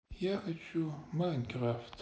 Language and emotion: Russian, sad